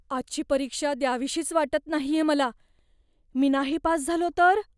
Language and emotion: Marathi, fearful